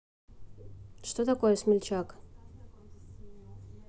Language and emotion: Russian, neutral